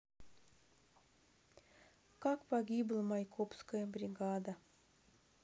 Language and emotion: Russian, sad